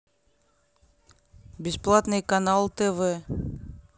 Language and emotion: Russian, neutral